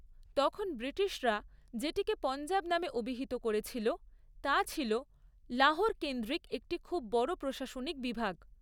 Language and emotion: Bengali, neutral